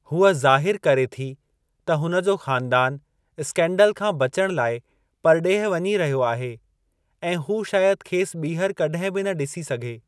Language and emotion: Sindhi, neutral